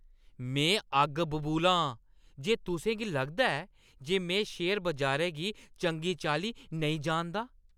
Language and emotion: Dogri, angry